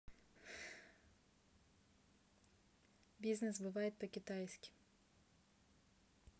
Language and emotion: Russian, neutral